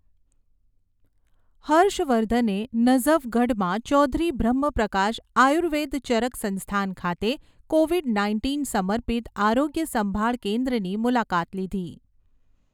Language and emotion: Gujarati, neutral